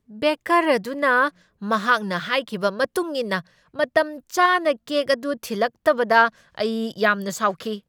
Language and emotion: Manipuri, angry